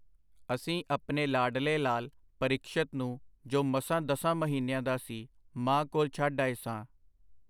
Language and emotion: Punjabi, neutral